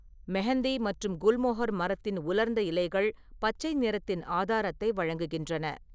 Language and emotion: Tamil, neutral